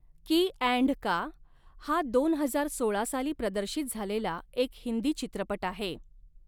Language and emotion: Marathi, neutral